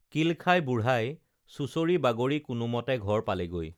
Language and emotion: Assamese, neutral